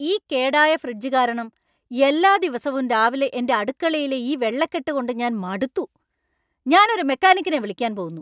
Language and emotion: Malayalam, angry